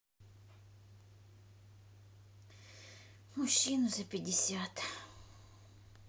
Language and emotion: Russian, sad